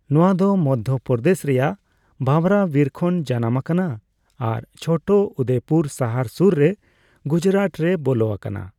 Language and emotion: Santali, neutral